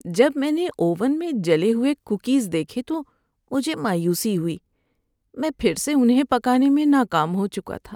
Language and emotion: Urdu, sad